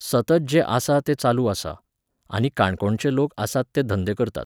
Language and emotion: Goan Konkani, neutral